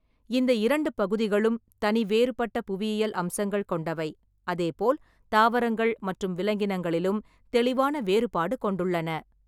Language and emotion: Tamil, neutral